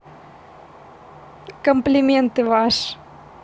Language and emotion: Russian, positive